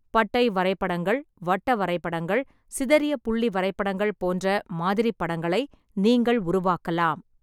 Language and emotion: Tamil, neutral